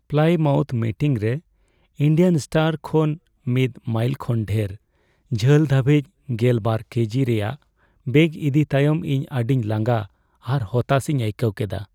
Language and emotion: Santali, sad